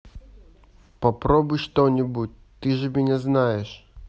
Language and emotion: Russian, neutral